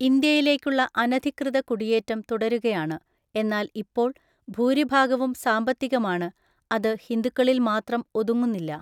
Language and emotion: Malayalam, neutral